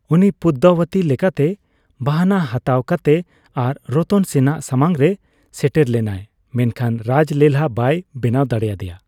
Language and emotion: Santali, neutral